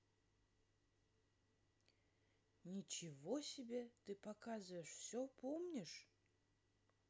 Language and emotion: Russian, neutral